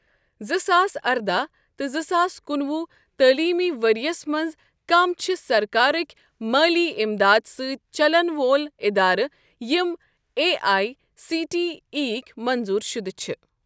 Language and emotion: Kashmiri, neutral